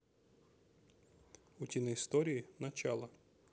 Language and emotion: Russian, neutral